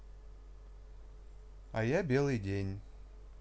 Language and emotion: Russian, neutral